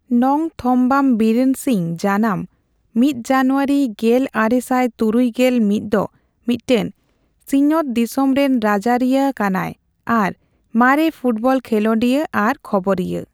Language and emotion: Santali, neutral